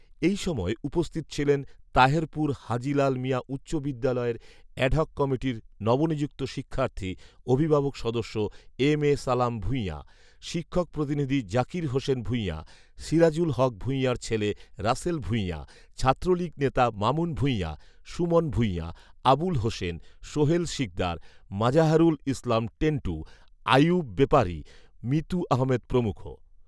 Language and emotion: Bengali, neutral